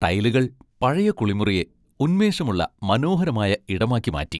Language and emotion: Malayalam, happy